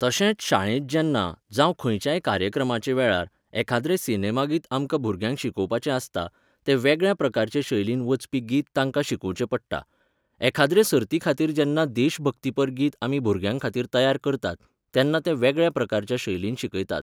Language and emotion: Goan Konkani, neutral